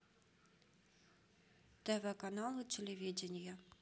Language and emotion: Russian, neutral